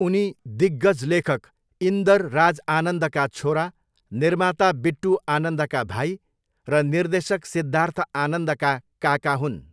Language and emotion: Nepali, neutral